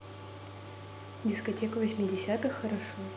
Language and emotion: Russian, neutral